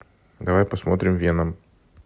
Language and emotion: Russian, neutral